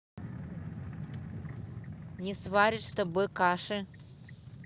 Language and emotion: Russian, angry